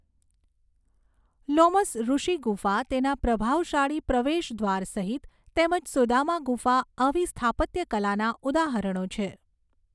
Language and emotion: Gujarati, neutral